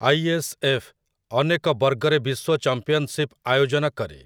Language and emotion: Odia, neutral